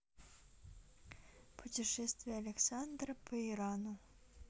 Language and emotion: Russian, neutral